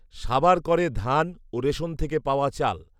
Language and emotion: Bengali, neutral